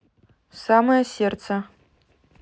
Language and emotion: Russian, neutral